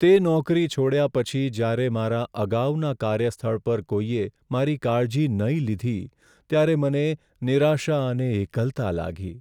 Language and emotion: Gujarati, sad